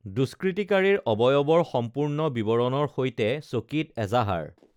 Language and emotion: Assamese, neutral